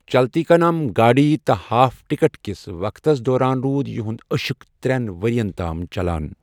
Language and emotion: Kashmiri, neutral